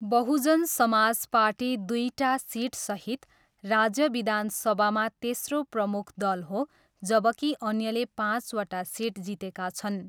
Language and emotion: Nepali, neutral